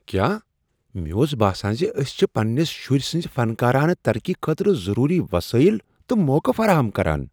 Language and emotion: Kashmiri, surprised